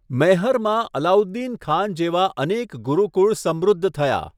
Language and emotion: Gujarati, neutral